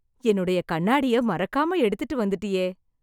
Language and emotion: Tamil, happy